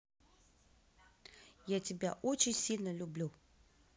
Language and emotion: Russian, positive